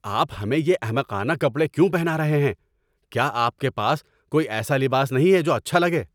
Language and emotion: Urdu, angry